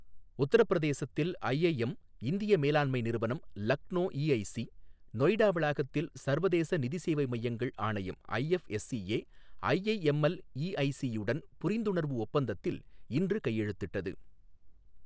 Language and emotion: Tamil, neutral